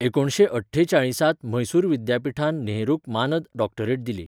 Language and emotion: Goan Konkani, neutral